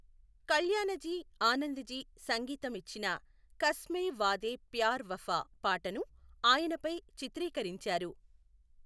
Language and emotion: Telugu, neutral